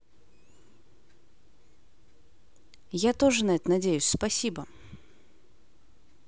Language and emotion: Russian, neutral